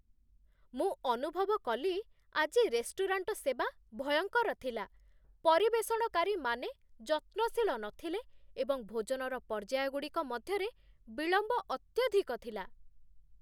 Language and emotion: Odia, disgusted